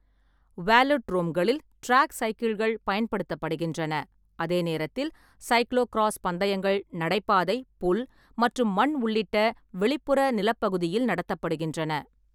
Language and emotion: Tamil, neutral